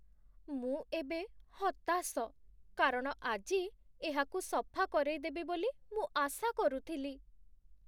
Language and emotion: Odia, sad